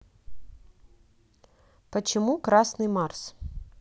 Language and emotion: Russian, neutral